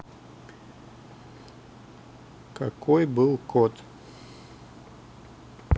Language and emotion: Russian, neutral